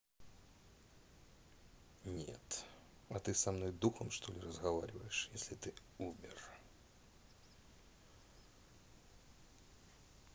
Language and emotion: Russian, neutral